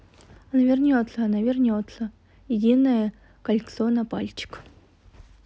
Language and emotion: Russian, neutral